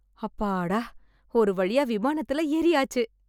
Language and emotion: Tamil, happy